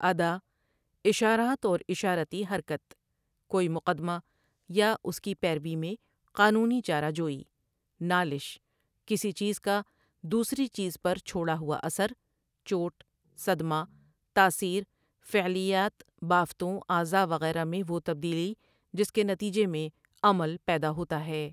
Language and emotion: Urdu, neutral